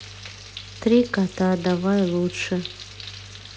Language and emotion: Russian, sad